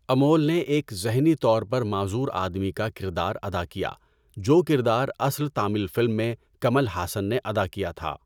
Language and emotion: Urdu, neutral